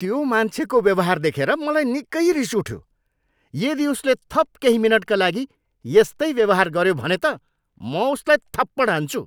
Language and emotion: Nepali, angry